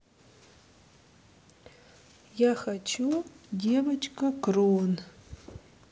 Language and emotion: Russian, neutral